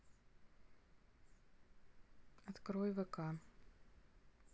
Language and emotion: Russian, neutral